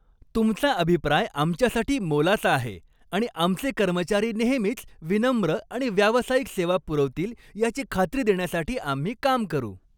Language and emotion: Marathi, happy